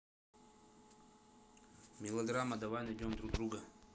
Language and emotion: Russian, neutral